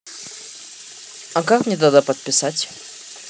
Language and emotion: Russian, neutral